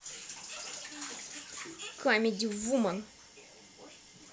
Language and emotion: Russian, angry